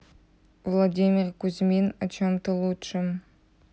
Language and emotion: Russian, neutral